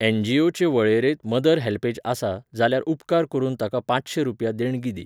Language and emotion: Goan Konkani, neutral